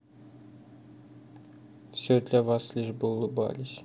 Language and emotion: Russian, sad